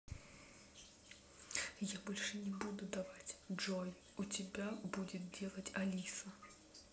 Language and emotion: Russian, neutral